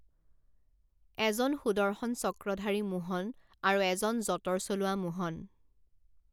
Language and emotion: Assamese, neutral